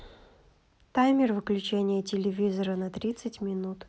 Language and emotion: Russian, neutral